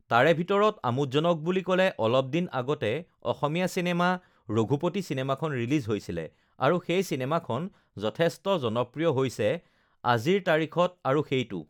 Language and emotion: Assamese, neutral